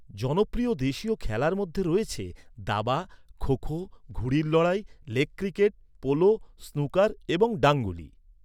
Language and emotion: Bengali, neutral